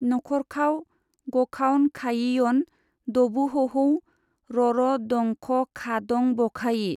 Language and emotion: Bodo, neutral